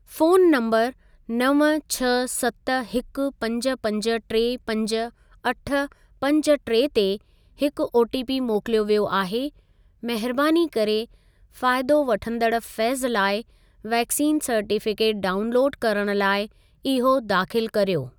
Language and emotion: Sindhi, neutral